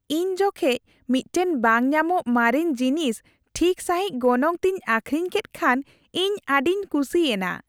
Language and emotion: Santali, happy